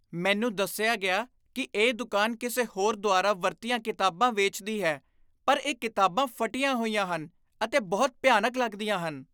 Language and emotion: Punjabi, disgusted